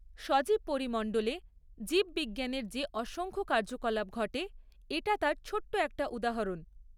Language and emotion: Bengali, neutral